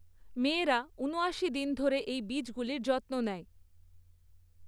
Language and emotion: Bengali, neutral